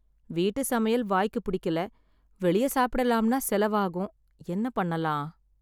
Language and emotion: Tamil, sad